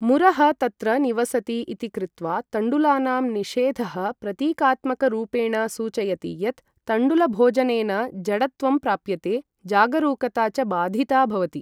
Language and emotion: Sanskrit, neutral